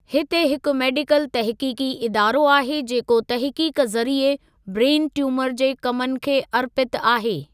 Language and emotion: Sindhi, neutral